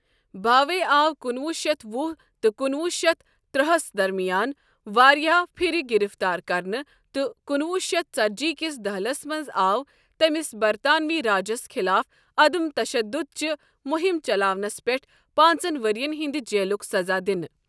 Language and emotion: Kashmiri, neutral